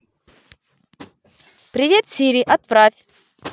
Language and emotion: Russian, positive